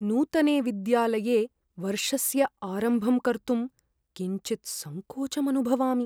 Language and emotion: Sanskrit, fearful